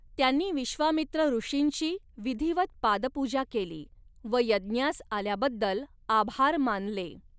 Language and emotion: Marathi, neutral